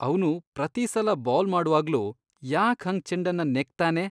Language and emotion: Kannada, disgusted